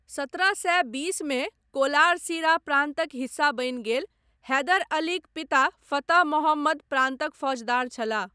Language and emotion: Maithili, neutral